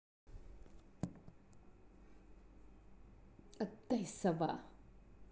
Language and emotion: Russian, angry